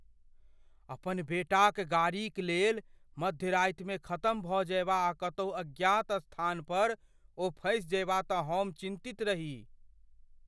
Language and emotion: Maithili, fearful